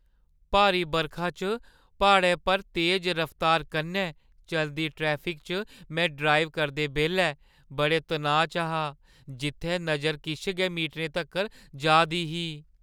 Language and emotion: Dogri, fearful